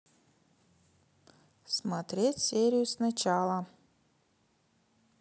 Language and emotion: Russian, neutral